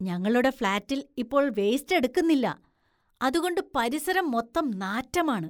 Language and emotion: Malayalam, disgusted